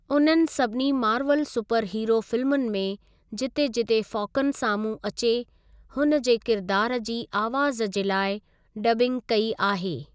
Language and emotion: Sindhi, neutral